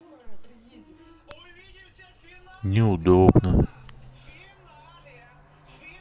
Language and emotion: Russian, sad